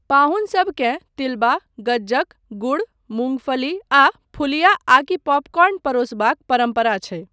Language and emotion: Maithili, neutral